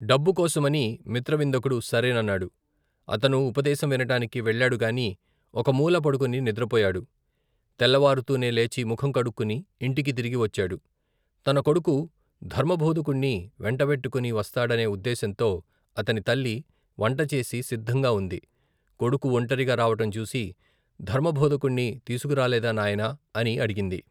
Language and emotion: Telugu, neutral